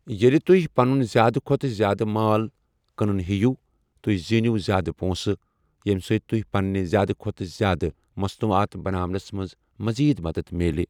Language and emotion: Kashmiri, neutral